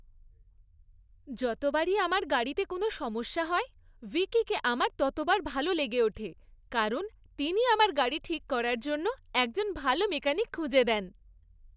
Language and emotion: Bengali, happy